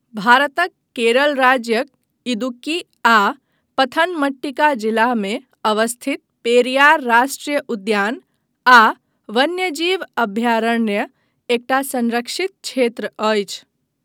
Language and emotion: Maithili, neutral